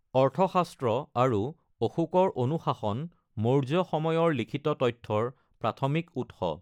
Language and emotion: Assamese, neutral